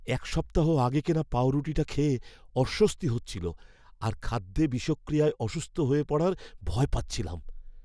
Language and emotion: Bengali, fearful